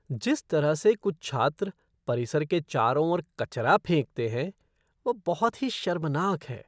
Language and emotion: Hindi, disgusted